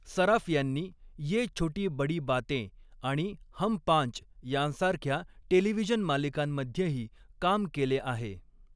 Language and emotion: Marathi, neutral